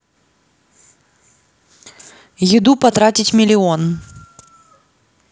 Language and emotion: Russian, neutral